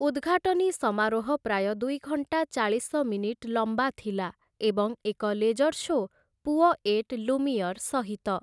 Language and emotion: Odia, neutral